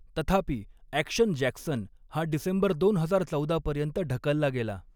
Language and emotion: Marathi, neutral